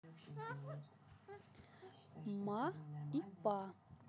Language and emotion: Russian, neutral